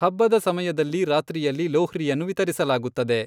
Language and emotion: Kannada, neutral